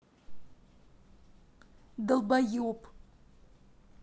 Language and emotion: Russian, angry